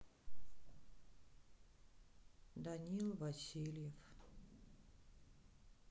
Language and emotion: Russian, sad